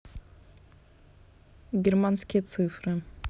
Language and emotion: Russian, neutral